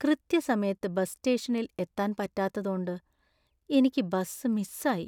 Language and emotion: Malayalam, sad